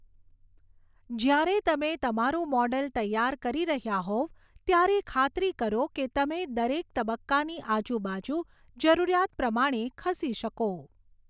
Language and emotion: Gujarati, neutral